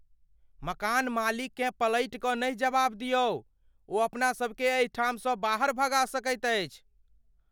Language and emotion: Maithili, fearful